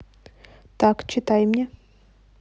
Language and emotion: Russian, neutral